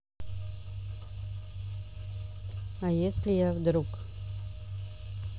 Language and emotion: Russian, neutral